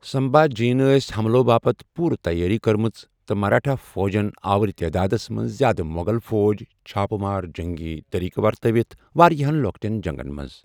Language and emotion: Kashmiri, neutral